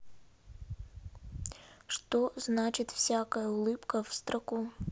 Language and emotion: Russian, neutral